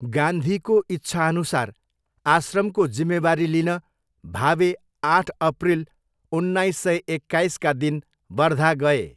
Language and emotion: Nepali, neutral